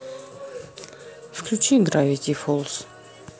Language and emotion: Russian, neutral